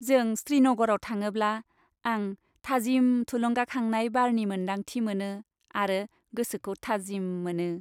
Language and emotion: Bodo, happy